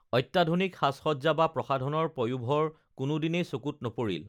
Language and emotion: Assamese, neutral